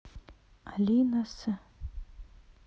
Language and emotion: Russian, neutral